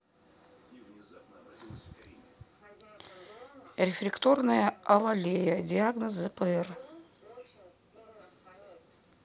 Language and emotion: Russian, neutral